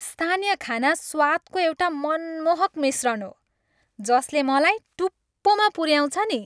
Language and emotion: Nepali, happy